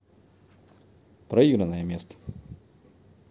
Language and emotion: Russian, neutral